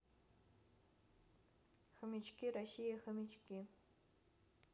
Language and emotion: Russian, neutral